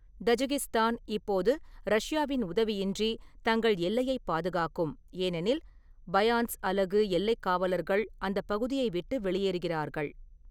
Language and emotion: Tamil, neutral